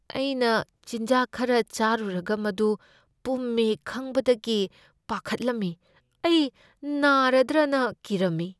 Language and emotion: Manipuri, fearful